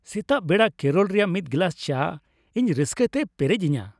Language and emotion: Santali, happy